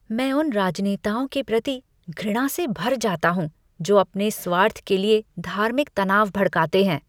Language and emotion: Hindi, disgusted